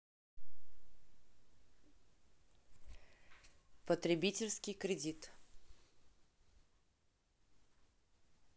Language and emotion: Russian, neutral